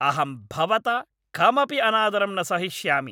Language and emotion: Sanskrit, angry